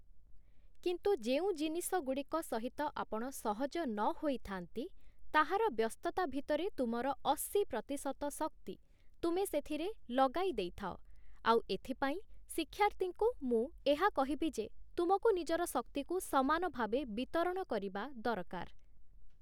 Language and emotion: Odia, neutral